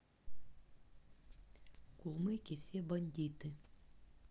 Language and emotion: Russian, neutral